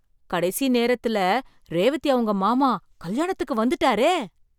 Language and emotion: Tamil, surprised